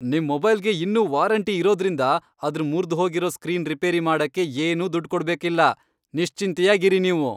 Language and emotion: Kannada, happy